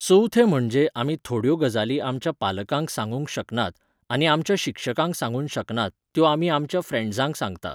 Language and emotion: Goan Konkani, neutral